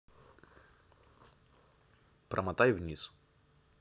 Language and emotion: Russian, neutral